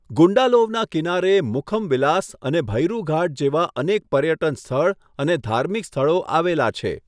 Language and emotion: Gujarati, neutral